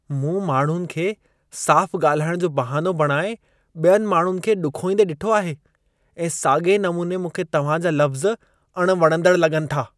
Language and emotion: Sindhi, disgusted